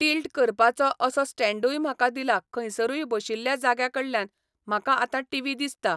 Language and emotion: Goan Konkani, neutral